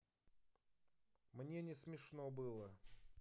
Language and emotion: Russian, neutral